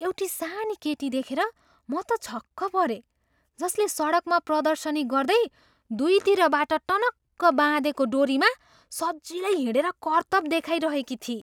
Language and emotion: Nepali, surprised